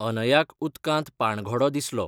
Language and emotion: Goan Konkani, neutral